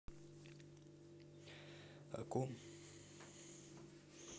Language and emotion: Russian, neutral